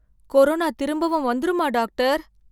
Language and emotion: Tamil, fearful